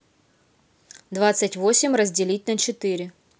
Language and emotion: Russian, neutral